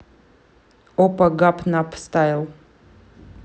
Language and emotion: Russian, neutral